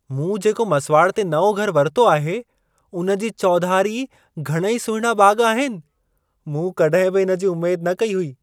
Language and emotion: Sindhi, surprised